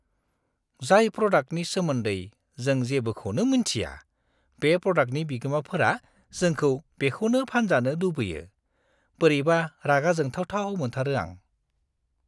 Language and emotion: Bodo, disgusted